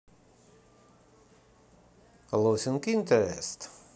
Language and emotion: Russian, neutral